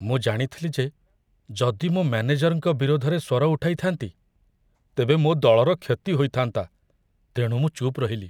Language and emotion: Odia, fearful